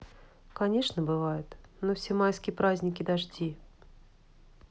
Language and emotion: Russian, sad